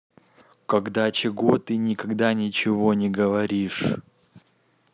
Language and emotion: Russian, neutral